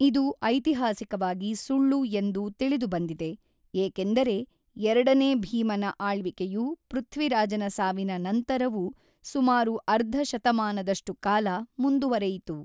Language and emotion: Kannada, neutral